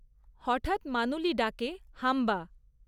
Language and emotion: Bengali, neutral